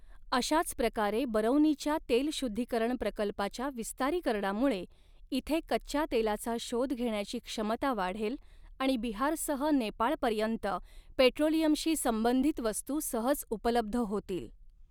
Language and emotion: Marathi, neutral